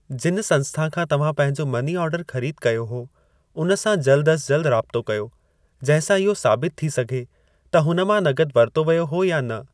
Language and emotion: Sindhi, neutral